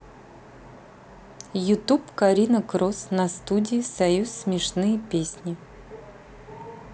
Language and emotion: Russian, neutral